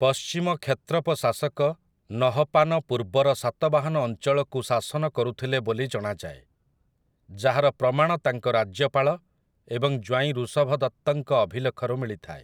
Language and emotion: Odia, neutral